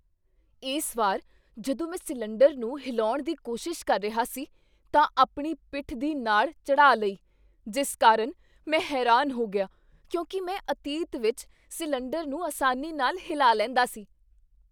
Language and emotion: Punjabi, surprised